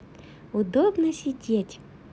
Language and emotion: Russian, positive